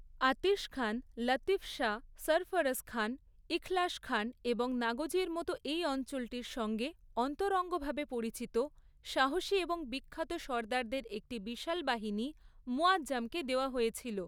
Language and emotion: Bengali, neutral